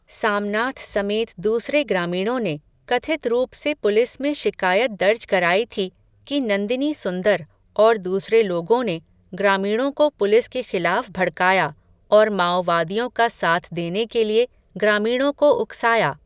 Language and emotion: Hindi, neutral